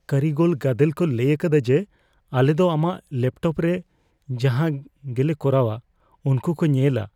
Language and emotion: Santali, fearful